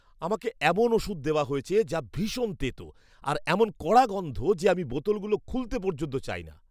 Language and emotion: Bengali, disgusted